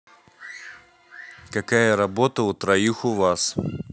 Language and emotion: Russian, neutral